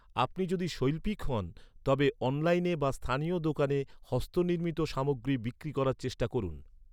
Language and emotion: Bengali, neutral